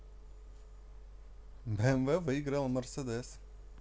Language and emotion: Russian, positive